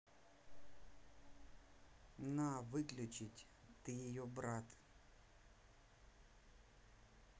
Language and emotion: Russian, neutral